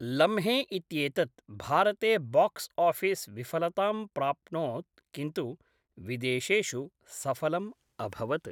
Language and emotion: Sanskrit, neutral